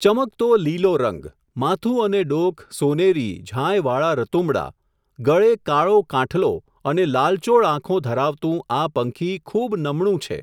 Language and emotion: Gujarati, neutral